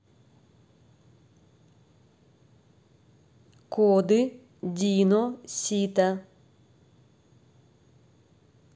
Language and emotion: Russian, neutral